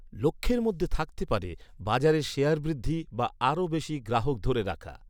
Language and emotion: Bengali, neutral